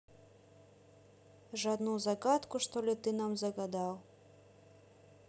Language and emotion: Russian, neutral